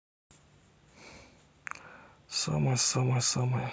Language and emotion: Russian, neutral